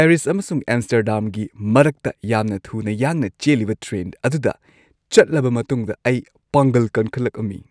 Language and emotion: Manipuri, happy